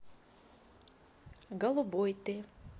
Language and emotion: Russian, neutral